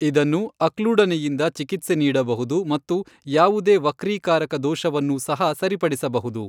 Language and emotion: Kannada, neutral